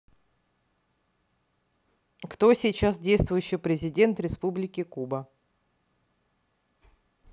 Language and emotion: Russian, neutral